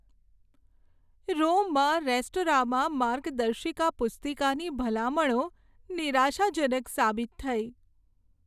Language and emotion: Gujarati, sad